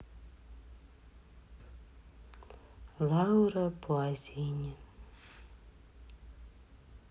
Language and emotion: Russian, sad